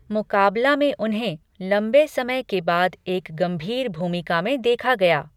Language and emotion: Hindi, neutral